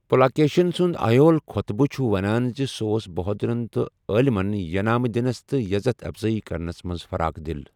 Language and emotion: Kashmiri, neutral